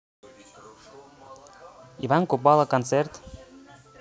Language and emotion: Russian, neutral